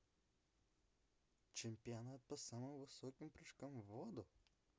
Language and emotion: Russian, neutral